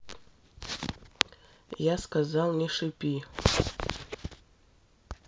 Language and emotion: Russian, neutral